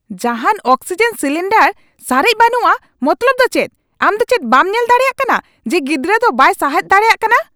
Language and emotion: Santali, angry